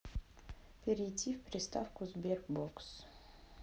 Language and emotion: Russian, sad